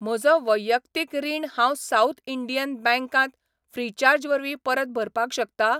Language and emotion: Goan Konkani, neutral